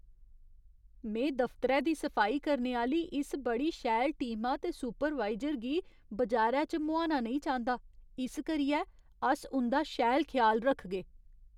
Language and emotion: Dogri, fearful